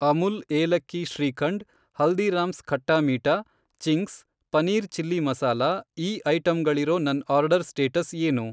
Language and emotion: Kannada, neutral